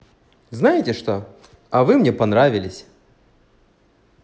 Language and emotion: Russian, positive